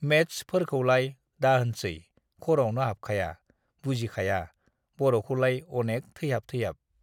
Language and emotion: Bodo, neutral